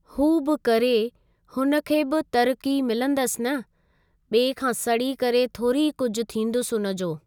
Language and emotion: Sindhi, neutral